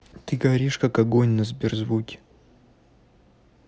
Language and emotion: Russian, neutral